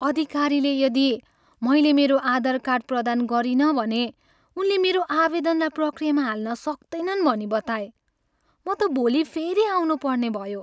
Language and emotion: Nepali, sad